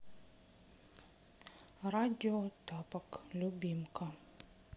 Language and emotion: Russian, sad